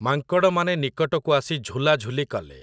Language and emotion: Odia, neutral